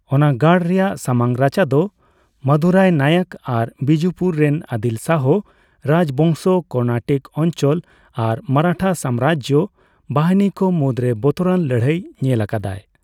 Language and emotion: Santali, neutral